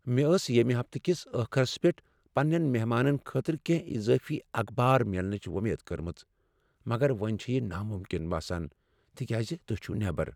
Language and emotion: Kashmiri, sad